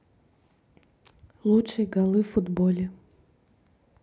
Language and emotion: Russian, neutral